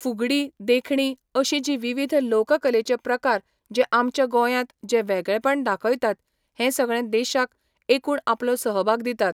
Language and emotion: Goan Konkani, neutral